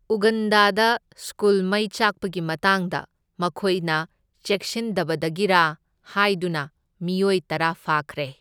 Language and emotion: Manipuri, neutral